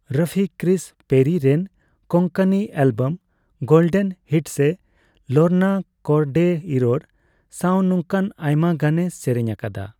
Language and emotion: Santali, neutral